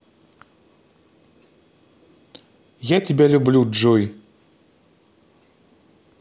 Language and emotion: Russian, neutral